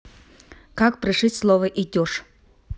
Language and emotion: Russian, neutral